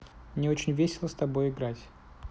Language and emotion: Russian, neutral